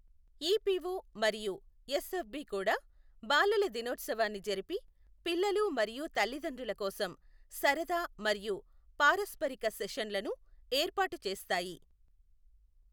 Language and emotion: Telugu, neutral